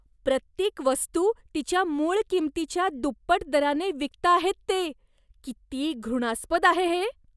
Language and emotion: Marathi, disgusted